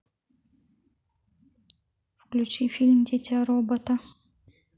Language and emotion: Russian, neutral